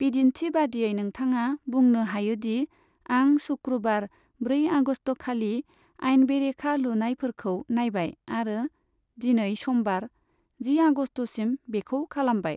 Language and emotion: Bodo, neutral